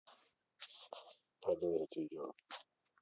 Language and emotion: Russian, neutral